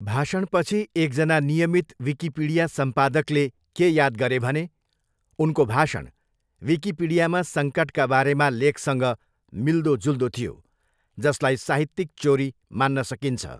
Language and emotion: Nepali, neutral